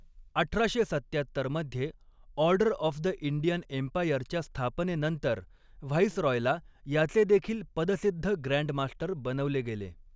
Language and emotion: Marathi, neutral